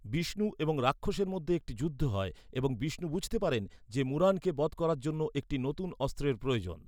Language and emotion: Bengali, neutral